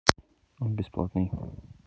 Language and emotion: Russian, neutral